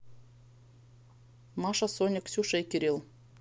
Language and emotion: Russian, neutral